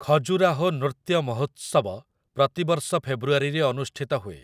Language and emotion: Odia, neutral